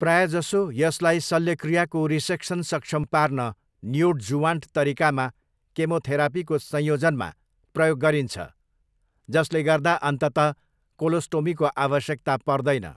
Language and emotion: Nepali, neutral